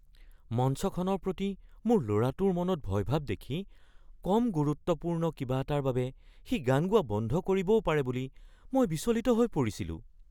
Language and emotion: Assamese, fearful